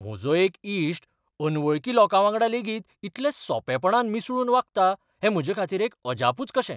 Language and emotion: Goan Konkani, surprised